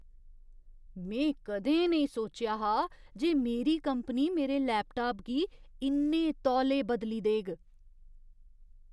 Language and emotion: Dogri, surprised